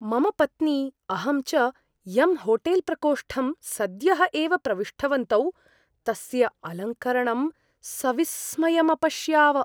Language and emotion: Sanskrit, surprised